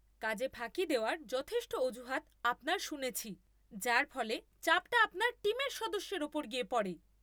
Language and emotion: Bengali, angry